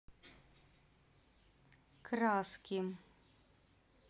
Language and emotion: Russian, neutral